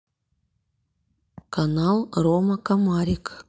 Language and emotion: Russian, neutral